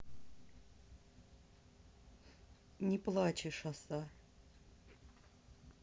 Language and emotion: Russian, neutral